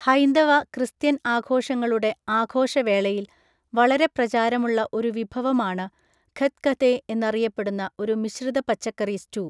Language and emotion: Malayalam, neutral